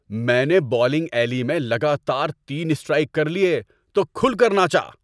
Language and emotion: Urdu, happy